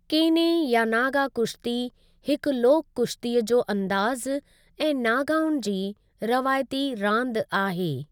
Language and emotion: Sindhi, neutral